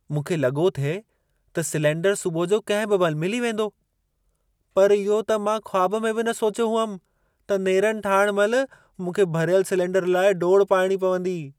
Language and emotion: Sindhi, surprised